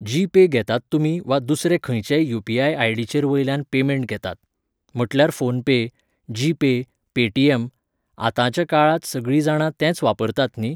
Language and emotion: Goan Konkani, neutral